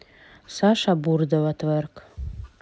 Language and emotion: Russian, neutral